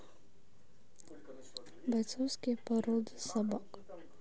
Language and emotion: Russian, neutral